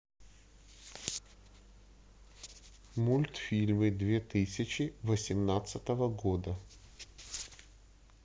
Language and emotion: Russian, neutral